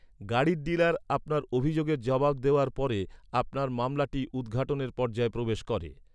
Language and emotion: Bengali, neutral